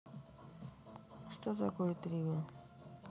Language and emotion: Russian, neutral